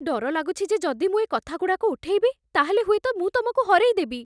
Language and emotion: Odia, fearful